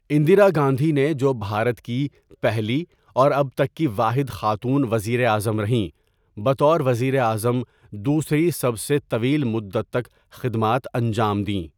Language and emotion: Urdu, neutral